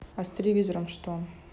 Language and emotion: Russian, neutral